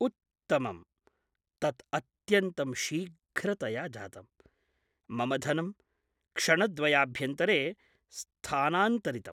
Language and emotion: Sanskrit, surprised